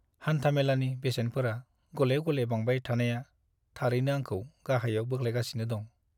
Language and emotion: Bodo, sad